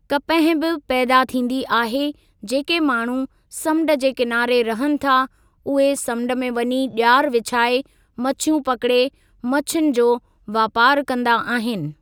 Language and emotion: Sindhi, neutral